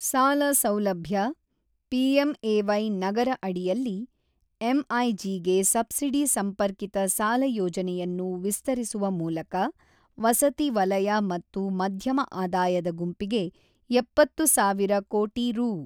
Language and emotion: Kannada, neutral